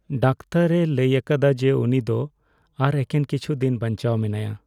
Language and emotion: Santali, sad